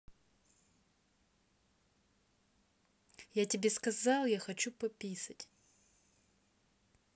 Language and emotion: Russian, angry